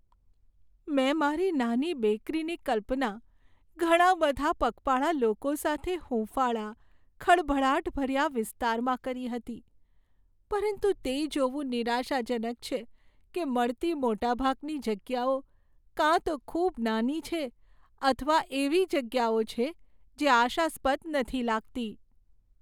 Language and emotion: Gujarati, sad